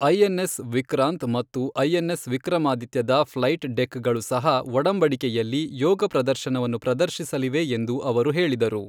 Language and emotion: Kannada, neutral